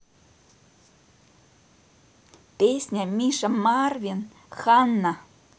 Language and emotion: Russian, neutral